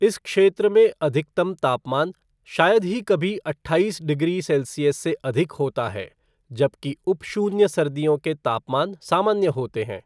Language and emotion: Hindi, neutral